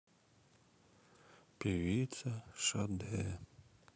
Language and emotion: Russian, sad